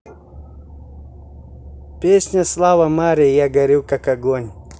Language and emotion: Russian, positive